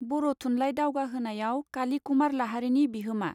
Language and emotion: Bodo, neutral